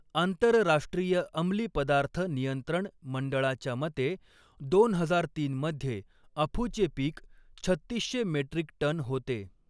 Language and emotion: Marathi, neutral